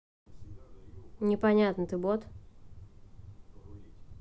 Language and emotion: Russian, neutral